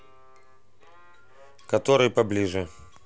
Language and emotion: Russian, neutral